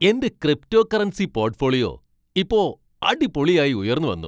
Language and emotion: Malayalam, happy